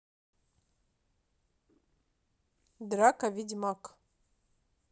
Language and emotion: Russian, neutral